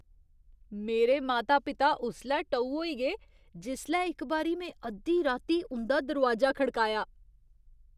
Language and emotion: Dogri, surprised